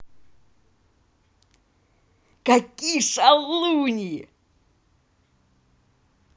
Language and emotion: Russian, positive